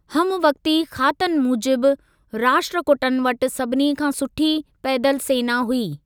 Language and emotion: Sindhi, neutral